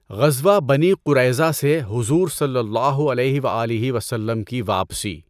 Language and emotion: Urdu, neutral